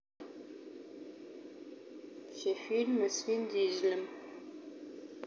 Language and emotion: Russian, neutral